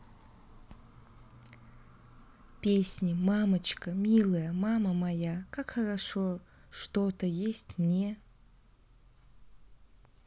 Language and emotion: Russian, neutral